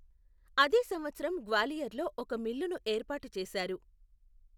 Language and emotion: Telugu, neutral